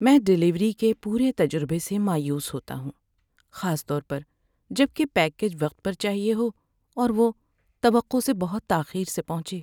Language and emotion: Urdu, sad